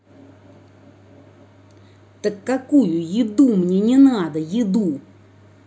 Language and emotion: Russian, angry